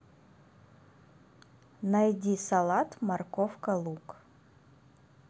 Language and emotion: Russian, neutral